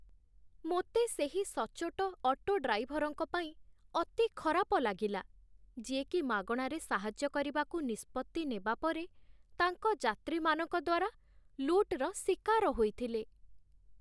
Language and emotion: Odia, sad